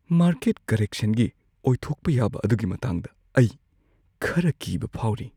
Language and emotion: Manipuri, fearful